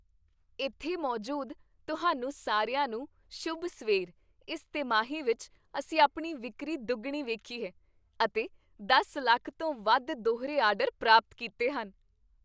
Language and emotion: Punjabi, happy